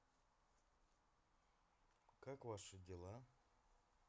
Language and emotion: Russian, neutral